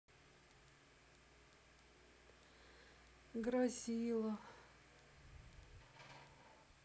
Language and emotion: Russian, sad